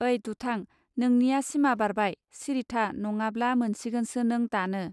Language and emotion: Bodo, neutral